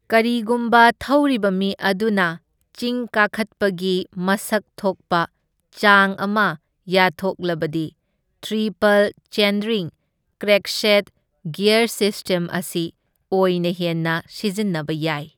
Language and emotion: Manipuri, neutral